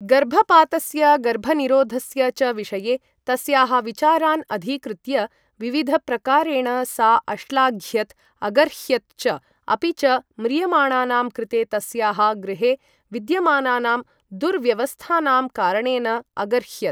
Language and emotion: Sanskrit, neutral